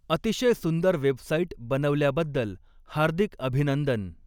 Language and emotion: Marathi, neutral